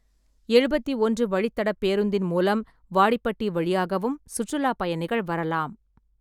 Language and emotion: Tamil, neutral